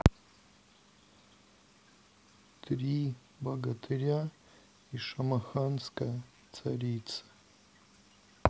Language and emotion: Russian, sad